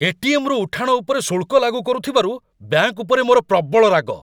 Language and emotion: Odia, angry